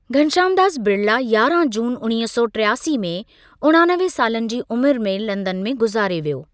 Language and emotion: Sindhi, neutral